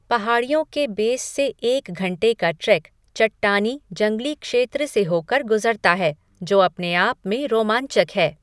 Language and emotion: Hindi, neutral